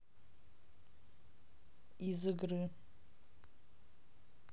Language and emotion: Russian, neutral